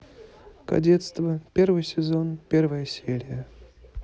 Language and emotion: Russian, neutral